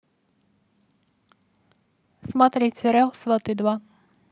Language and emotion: Russian, neutral